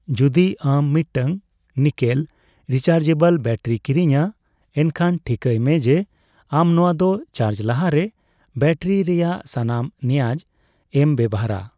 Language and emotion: Santali, neutral